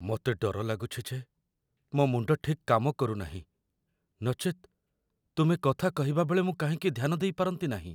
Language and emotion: Odia, fearful